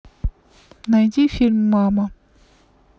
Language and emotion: Russian, neutral